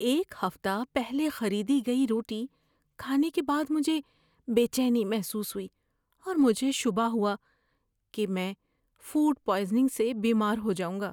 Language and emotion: Urdu, fearful